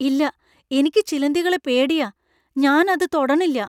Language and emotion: Malayalam, fearful